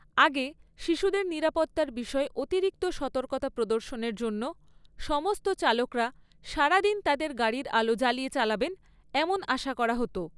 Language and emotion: Bengali, neutral